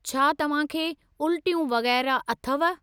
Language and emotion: Sindhi, neutral